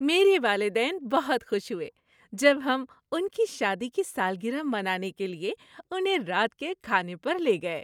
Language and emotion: Urdu, happy